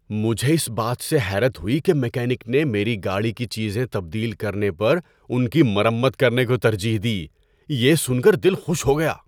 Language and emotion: Urdu, surprised